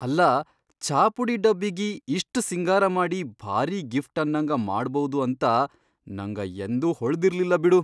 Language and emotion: Kannada, surprised